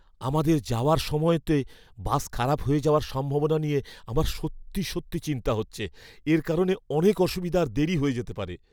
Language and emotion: Bengali, fearful